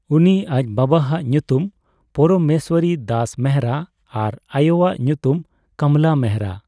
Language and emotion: Santali, neutral